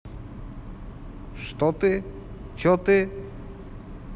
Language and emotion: Russian, neutral